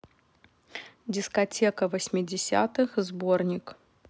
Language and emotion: Russian, neutral